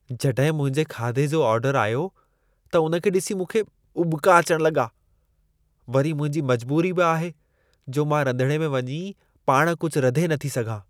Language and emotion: Sindhi, disgusted